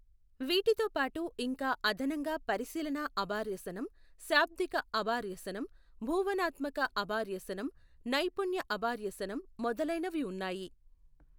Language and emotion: Telugu, neutral